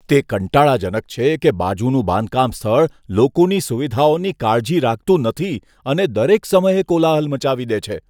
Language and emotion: Gujarati, disgusted